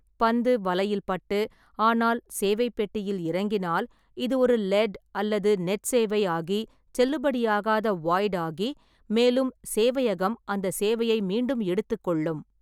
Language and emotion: Tamil, neutral